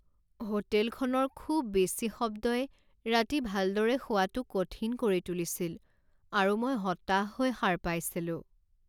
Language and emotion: Assamese, sad